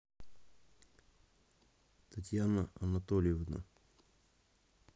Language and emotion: Russian, neutral